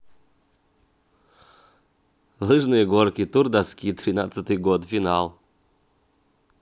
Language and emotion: Russian, neutral